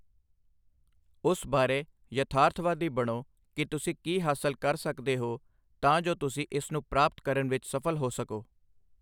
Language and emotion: Punjabi, neutral